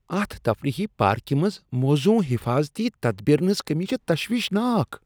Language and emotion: Kashmiri, disgusted